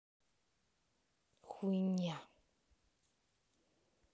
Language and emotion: Russian, angry